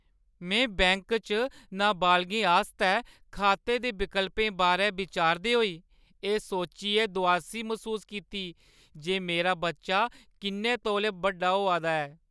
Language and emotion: Dogri, sad